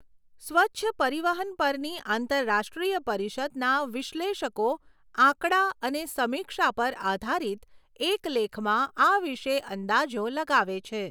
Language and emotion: Gujarati, neutral